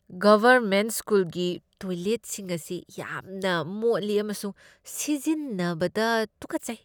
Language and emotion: Manipuri, disgusted